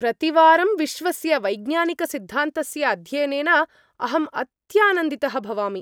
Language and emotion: Sanskrit, happy